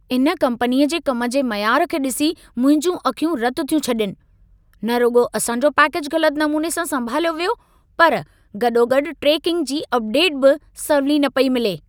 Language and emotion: Sindhi, angry